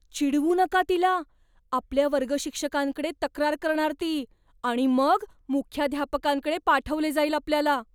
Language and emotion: Marathi, fearful